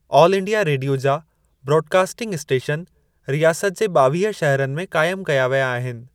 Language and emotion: Sindhi, neutral